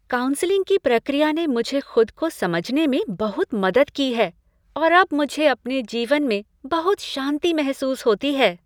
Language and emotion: Hindi, happy